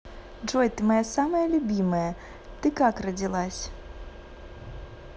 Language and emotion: Russian, positive